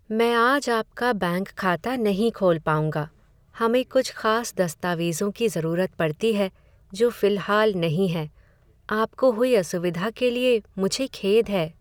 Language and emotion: Hindi, sad